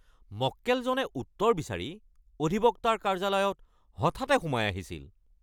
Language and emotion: Assamese, angry